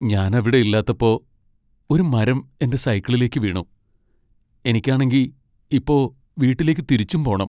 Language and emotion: Malayalam, sad